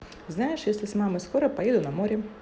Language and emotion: Russian, positive